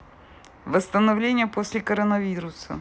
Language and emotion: Russian, neutral